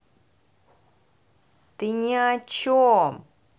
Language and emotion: Russian, angry